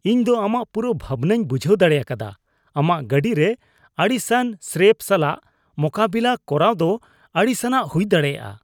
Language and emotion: Santali, disgusted